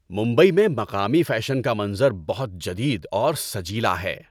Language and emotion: Urdu, happy